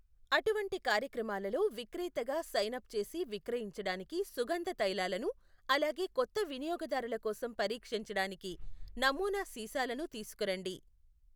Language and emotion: Telugu, neutral